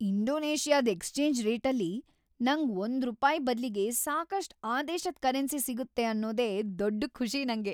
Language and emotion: Kannada, happy